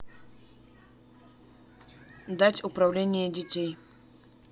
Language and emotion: Russian, neutral